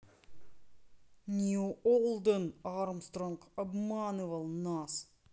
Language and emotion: Russian, neutral